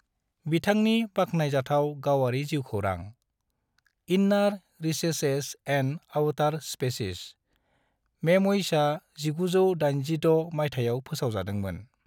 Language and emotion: Bodo, neutral